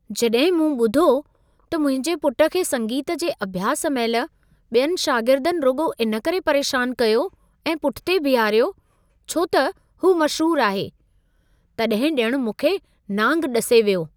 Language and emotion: Sindhi, surprised